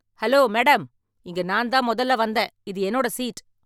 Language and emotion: Tamil, angry